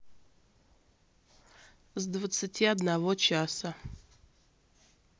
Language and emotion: Russian, neutral